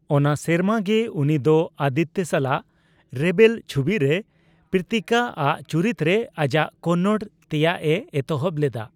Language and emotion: Santali, neutral